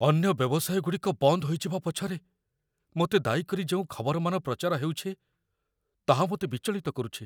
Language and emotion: Odia, fearful